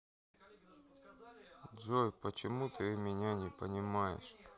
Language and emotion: Russian, sad